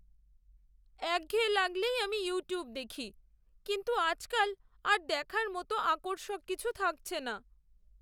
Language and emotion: Bengali, sad